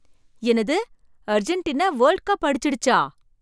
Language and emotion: Tamil, surprised